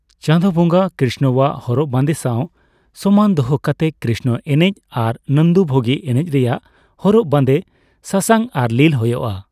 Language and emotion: Santali, neutral